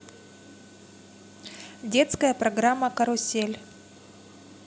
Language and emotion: Russian, neutral